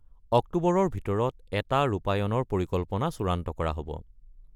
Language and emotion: Assamese, neutral